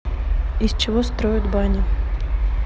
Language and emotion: Russian, neutral